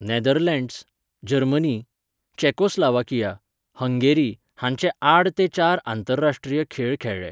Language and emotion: Goan Konkani, neutral